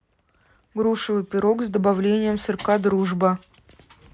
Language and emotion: Russian, neutral